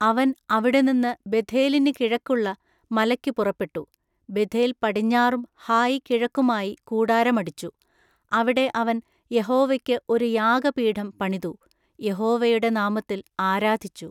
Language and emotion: Malayalam, neutral